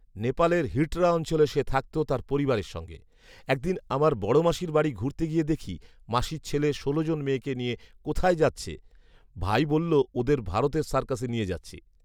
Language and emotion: Bengali, neutral